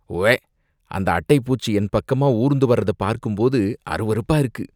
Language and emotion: Tamil, disgusted